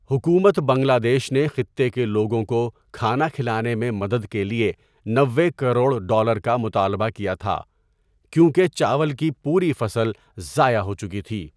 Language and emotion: Urdu, neutral